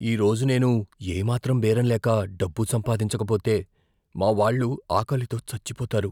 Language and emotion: Telugu, fearful